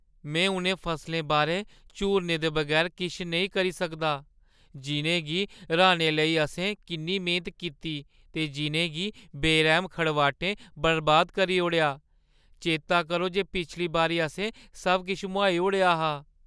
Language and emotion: Dogri, fearful